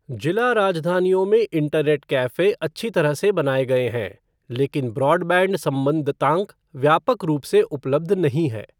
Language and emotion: Hindi, neutral